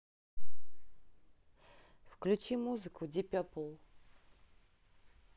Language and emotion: Russian, neutral